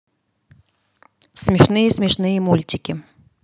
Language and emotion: Russian, neutral